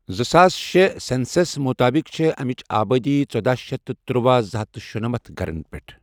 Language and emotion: Kashmiri, neutral